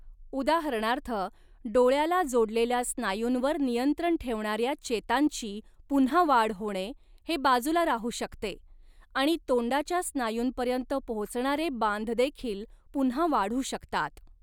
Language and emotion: Marathi, neutral